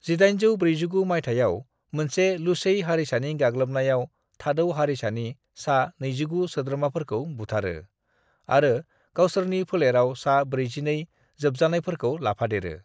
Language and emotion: Bodo, neutral